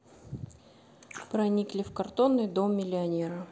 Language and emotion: Russian, neutral